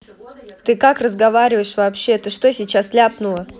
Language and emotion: Russian, angry